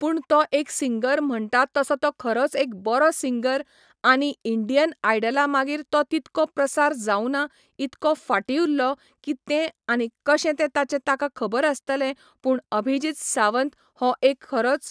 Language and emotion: Goan Konkani, neutral